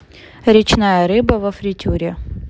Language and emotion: Russian, neutral